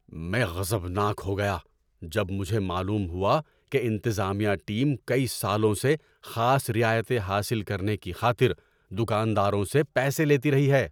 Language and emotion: Urdu, angry